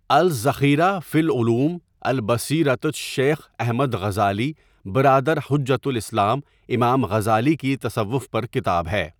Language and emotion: Urdu, neutral